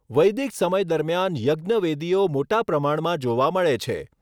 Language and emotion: Gujarati, neutral